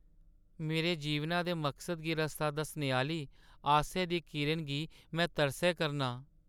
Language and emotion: Dogri, sad